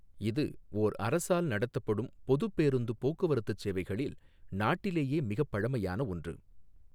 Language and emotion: Tamil, neutral